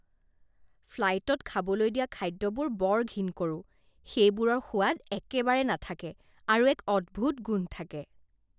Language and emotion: Assamese, disgusted